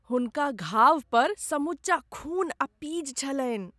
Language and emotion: Maithili, disgusted